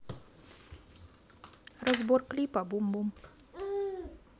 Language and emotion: Russian, neutral